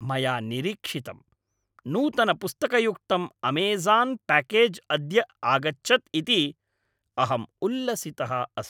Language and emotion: Sanskrit, happy